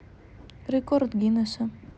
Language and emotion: Russian, neutral